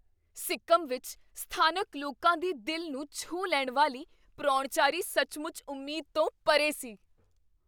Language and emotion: Punjabi, surprised